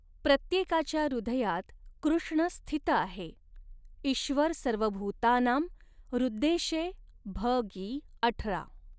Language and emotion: Marathi, neutral